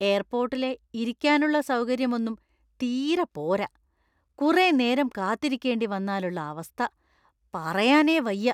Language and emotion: Malayalam, disgusted